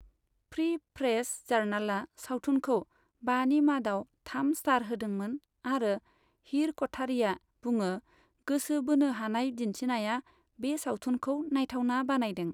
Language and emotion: Bodo, neutral